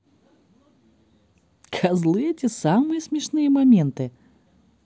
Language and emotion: Russian, positive